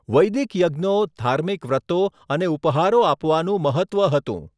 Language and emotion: Gujarati, neutral